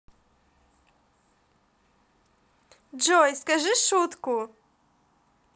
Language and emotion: Russian, positive